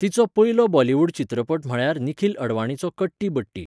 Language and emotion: Goan Konkani, neutral